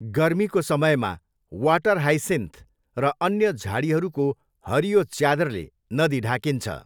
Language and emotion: Nepali, neutral